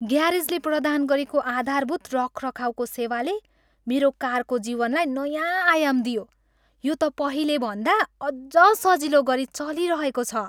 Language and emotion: Nepali, happy